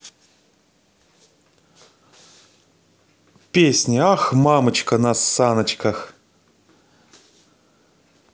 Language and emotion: Russian, positive